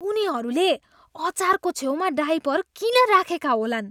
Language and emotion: Nepali, disgusted